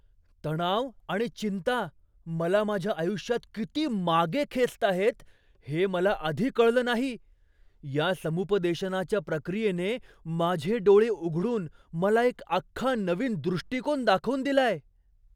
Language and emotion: Marathi, surprised